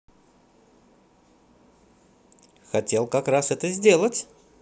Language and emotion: Russian, positive